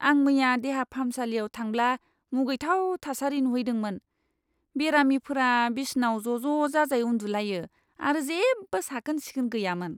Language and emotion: Bodo, disgusted